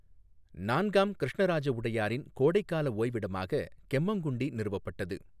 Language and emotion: Tamil, neutral